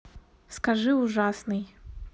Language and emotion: Russian, neutral